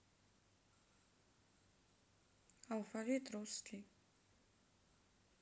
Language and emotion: Russian, neutral